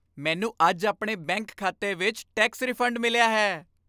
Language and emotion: Punjabi, happy